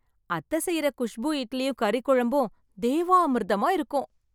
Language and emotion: Tamil, happy